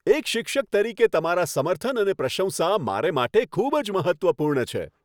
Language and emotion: Gujarati, happy